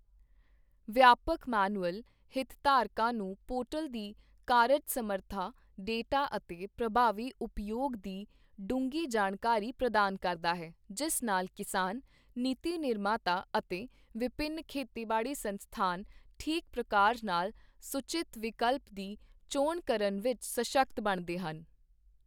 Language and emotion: Punjabi, neutral